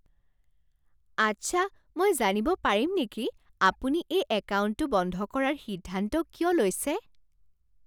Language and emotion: Assamese, surprised